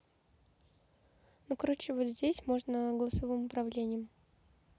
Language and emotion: Russian, neutral